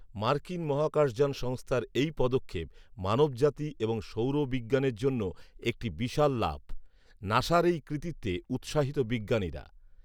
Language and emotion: Bengali, neutral